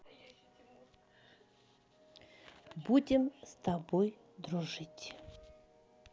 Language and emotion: Russian, neutral